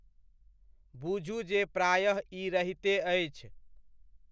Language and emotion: Maithili, neutral